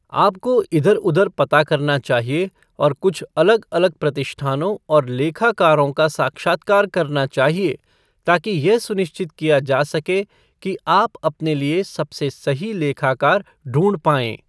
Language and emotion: Hindi, neutral